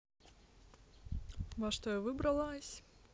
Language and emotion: Russian, positive